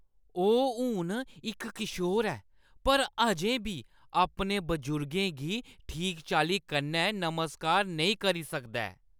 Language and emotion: Dogri, disgusted